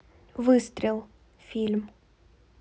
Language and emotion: Russian, neutral